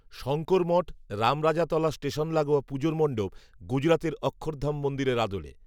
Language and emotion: Bengali, neutral